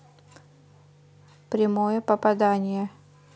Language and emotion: Russian, neutral